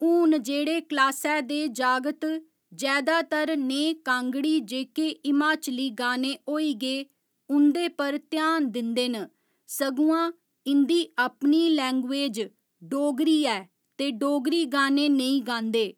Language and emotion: Dogri, neutral